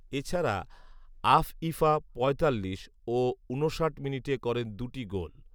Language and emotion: Bengali, neutral